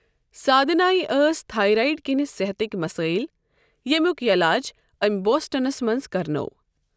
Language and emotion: Kashmiri, neutral